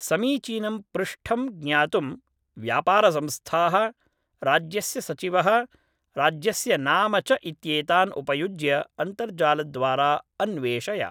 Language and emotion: Sanskrit, neutral